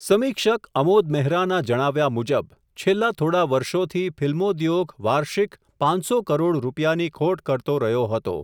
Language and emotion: Gujarati, neutral